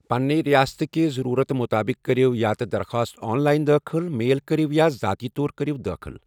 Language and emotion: Kashmiri, neutral